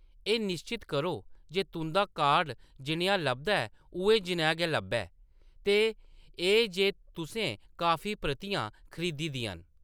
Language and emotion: Dogri, neutral